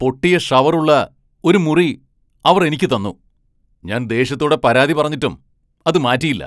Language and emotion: Malayalam, angry